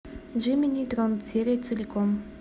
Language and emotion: Russian, neutral